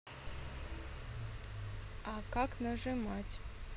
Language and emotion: Russian, neutral